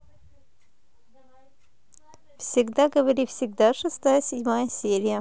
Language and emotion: Russian, positive